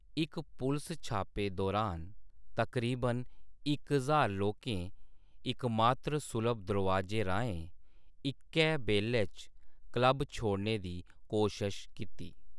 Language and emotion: Dogri, neutral